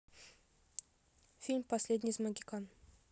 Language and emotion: Russian, neutral